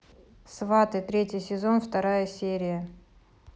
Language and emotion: Russian, neutral